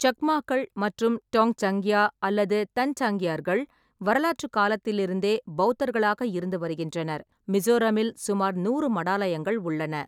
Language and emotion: Tamil, neutral